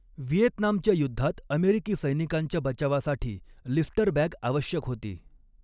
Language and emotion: Marathi, neutral